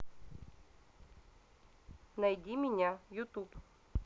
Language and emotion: Russian, neutral